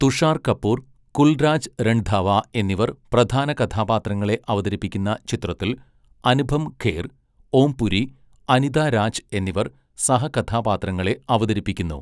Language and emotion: Malayalam, neutral